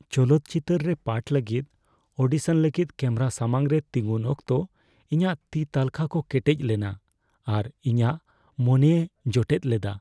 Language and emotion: Santali, fearful